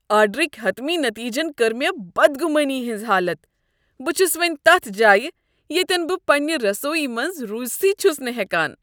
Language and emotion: Kashmiri, disgusted